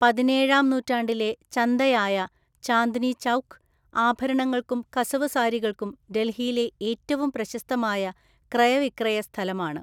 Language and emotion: Malayalam, neutral